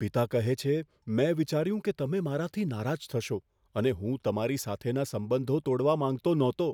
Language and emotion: Gujarati, fearful